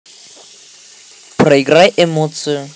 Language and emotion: Russian, neutral